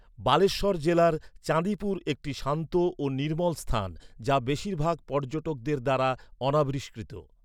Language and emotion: Bengali, neutral